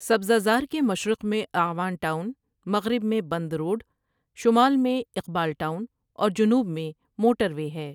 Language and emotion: Urdu, neutral